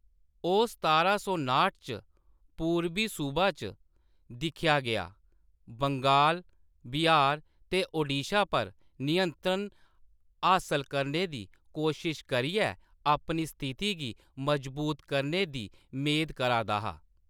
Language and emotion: Dogri, neutral